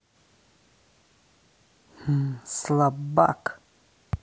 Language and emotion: Russian, angry